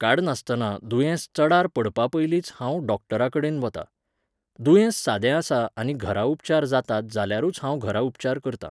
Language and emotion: Goan Konkani, neutral